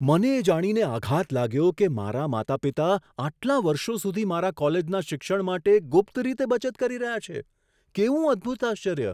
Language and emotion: Gujarati, surprised